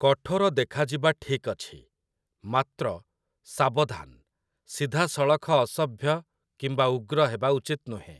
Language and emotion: Odia, neutral